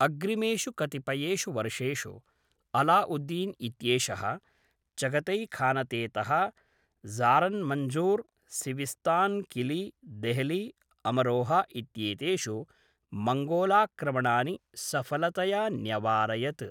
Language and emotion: Sanskrit, neutral